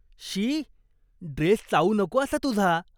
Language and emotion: Marathi, disgusted